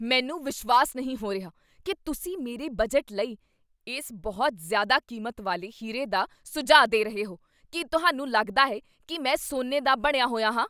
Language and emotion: Punjabi, angry